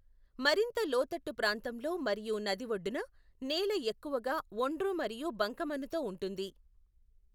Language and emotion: Telugu, neutral